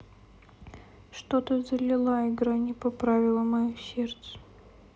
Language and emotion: Russian, sad